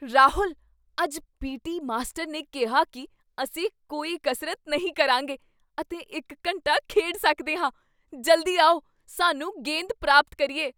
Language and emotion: Punjabi, surprised